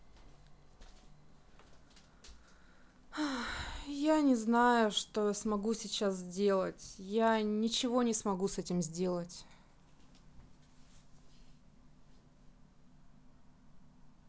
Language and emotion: Russian, sad